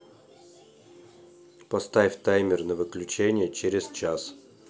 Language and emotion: Russian, neutral